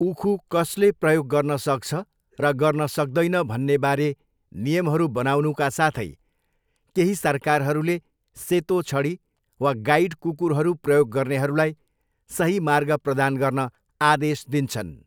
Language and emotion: Nepali, neutral